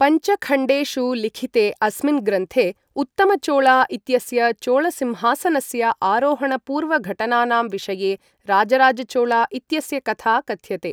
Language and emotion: Sanskrit, neutral